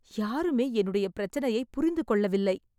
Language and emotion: Tamil, sad